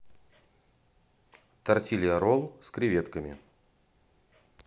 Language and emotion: Russian, neutral